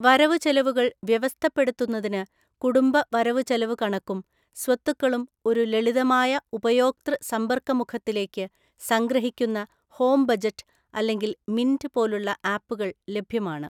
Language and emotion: Malayalam, neutral